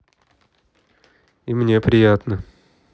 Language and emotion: Russian, neutral